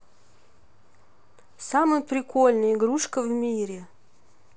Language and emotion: Russian, neutral